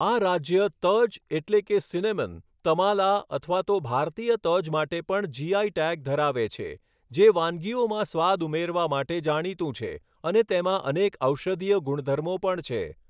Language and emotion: Gujarati, neutral